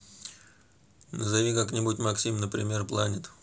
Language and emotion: Russian, neutral